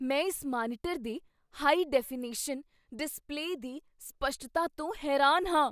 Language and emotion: Punjabi, surprised